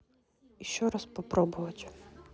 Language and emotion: Russian, neutral